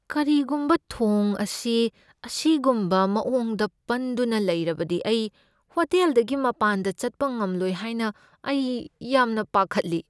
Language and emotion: Manipuri, fearful